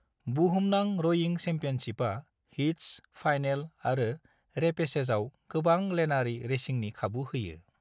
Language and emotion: Bodo, neutral